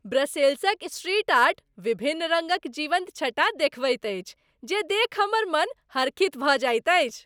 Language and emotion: Maithili, happy